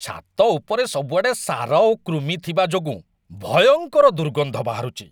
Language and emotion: Odia, disgusted